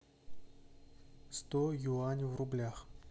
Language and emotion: Russian, neutral